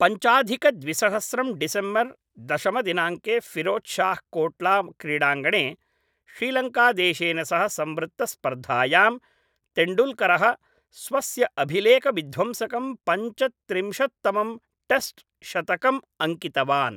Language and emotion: Sanskrit, neutral